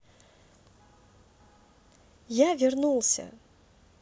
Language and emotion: Russian, positive